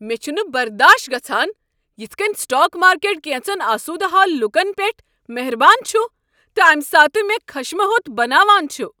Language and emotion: Kashmiri, angry